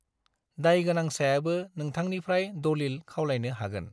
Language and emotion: Bodo, neutral